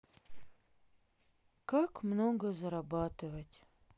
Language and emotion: Russian, sad